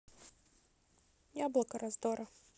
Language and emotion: Russian, neutral